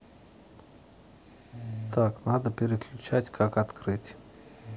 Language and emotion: Russian, neutral